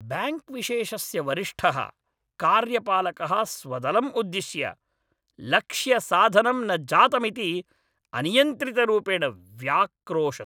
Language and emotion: Sanskrit, angry